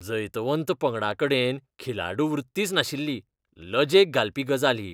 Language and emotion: Goan Konkani, disgusted